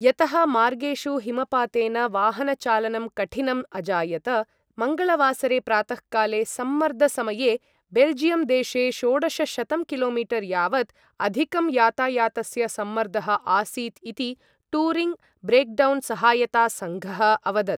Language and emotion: Sanskrit, neutral